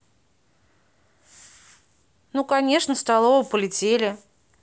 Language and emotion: Russian, neutral